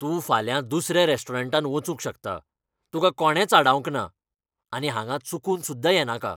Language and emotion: Goan Konkani, angry